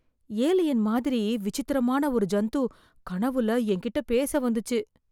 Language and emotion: Tamil, fearful